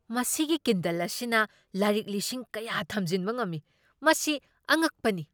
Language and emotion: Manipuri, surprised